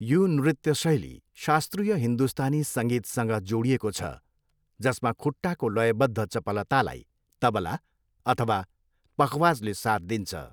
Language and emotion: Nepali, neutral